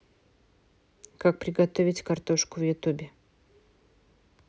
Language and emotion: Russian, neutral